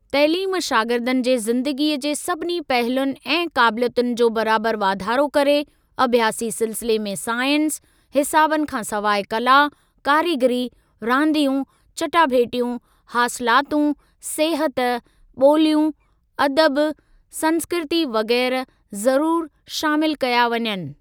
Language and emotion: Sindhi, neutral